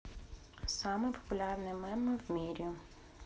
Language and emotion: Russian, neutral